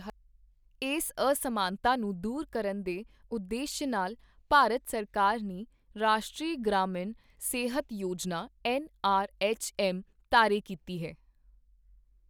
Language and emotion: Punjabi, neutral